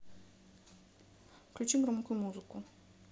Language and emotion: Russian, neutral